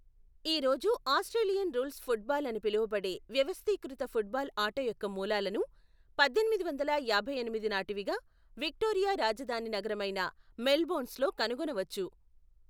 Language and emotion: Telugu, neutral